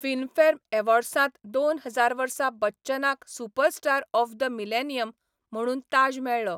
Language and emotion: Goan Konkani, neutral